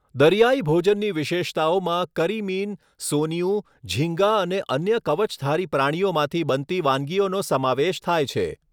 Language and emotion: Gujarati, neutral